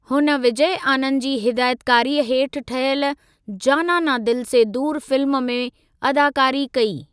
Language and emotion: Sindhi, neutral